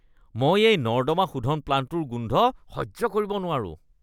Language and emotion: Assamese, disgusted